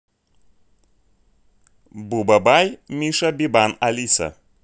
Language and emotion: Russian, neutral